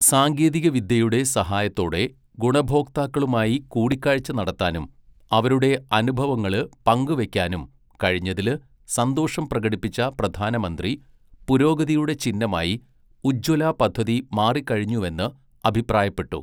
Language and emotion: Malayalam, neutral